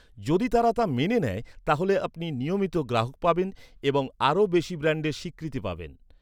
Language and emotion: Bengali, neutral